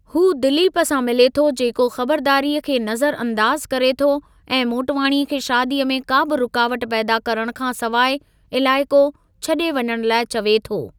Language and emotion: Sindhi, neutral